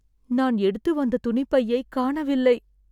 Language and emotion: Tamil, sad